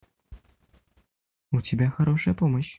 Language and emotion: Russian, positive